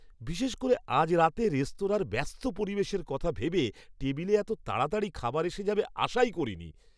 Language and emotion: Bengali, surprised